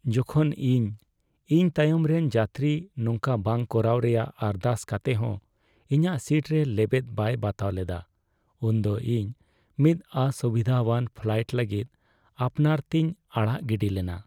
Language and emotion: Santali, sad